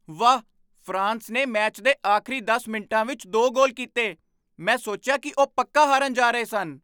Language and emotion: Punjabi, surprised